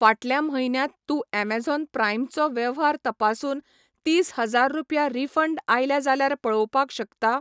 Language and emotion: Goan Konkani, neutral